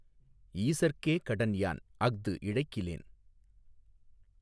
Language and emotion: Tamil, neutral